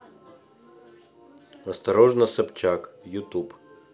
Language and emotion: Russian, neutral